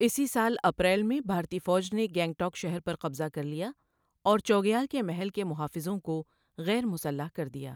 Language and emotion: Urdu, neutral